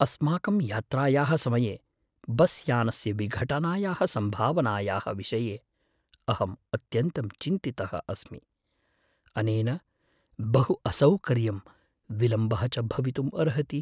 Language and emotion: Sanskrit, fearful